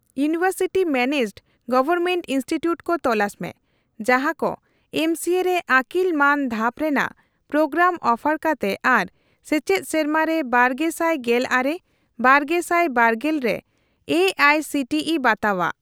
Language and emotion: Santali, neutral